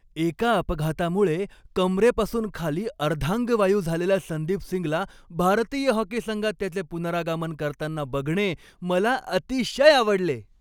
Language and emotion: Marathi, happy